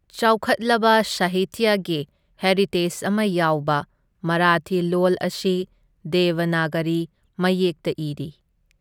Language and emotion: Manipuri, neutral